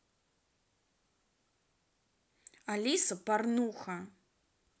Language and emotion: Russian, angry